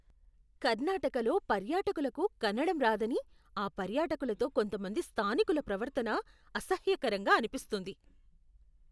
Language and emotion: Telugu, disgusted